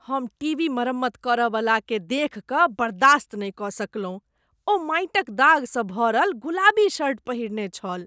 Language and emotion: Maithili, disgusted